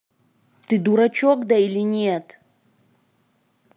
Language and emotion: Russian, angry